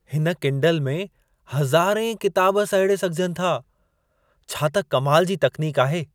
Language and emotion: Sindhi, surprised